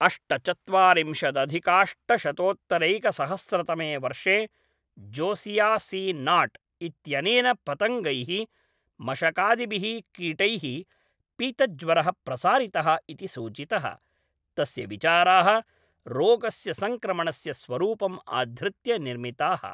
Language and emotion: Sanskrit, neutral